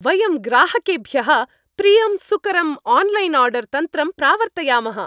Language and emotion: Sanskrit, happy